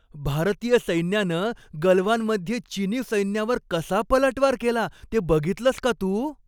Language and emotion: Marathi, happy